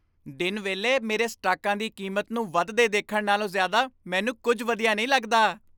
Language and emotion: Punjabi, happy